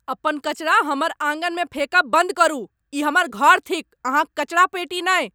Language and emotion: Maithili, angry